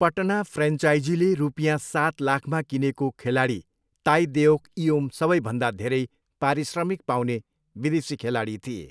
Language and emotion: Nepali, neutral